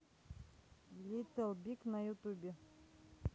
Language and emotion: Russian, neutral